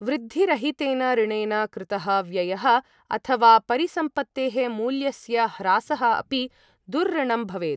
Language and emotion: Sanskrit, neutral